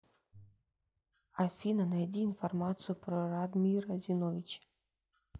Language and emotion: Russian, neutral